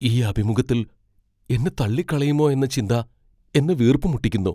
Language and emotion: Malayalam, fearful